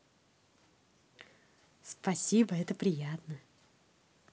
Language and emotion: Russian, positive